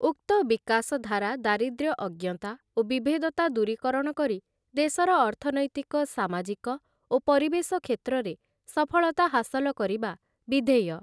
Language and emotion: Odia, neutral